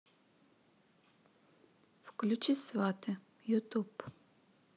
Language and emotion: Russian, neutral